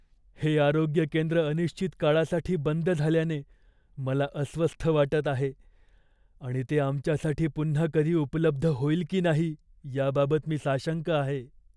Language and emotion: Marathi, fearful